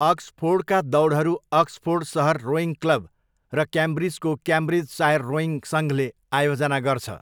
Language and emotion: Nepali, neutral